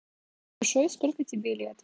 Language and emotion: Russian, neutral